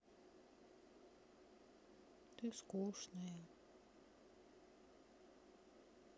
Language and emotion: Russian, sad